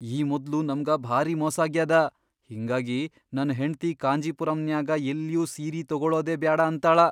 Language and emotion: Kannada, fearful